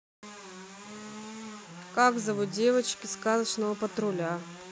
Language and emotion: Russian, neutral